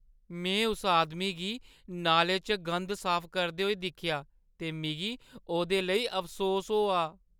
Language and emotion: Dogri, sad